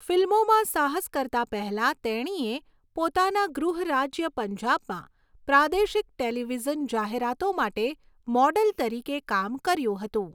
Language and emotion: Gujarati, neutral